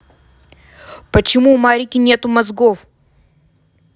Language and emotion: Russian, angry